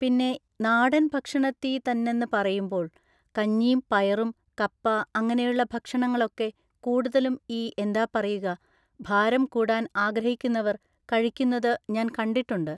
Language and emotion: Malayalam, neutral